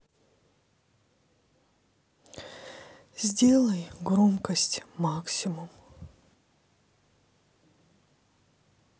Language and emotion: Russian, sad